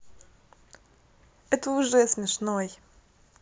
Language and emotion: Russian, positive